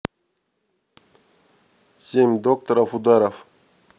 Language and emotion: Russian, neutral